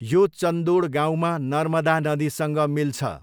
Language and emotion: Nepali, neutral